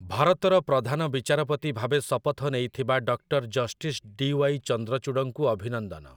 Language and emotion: Odia, neutral